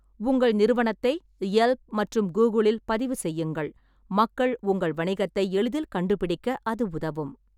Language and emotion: Tamil, neutral